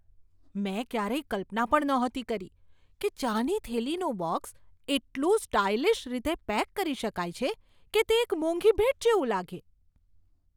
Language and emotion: Gujarati, surprised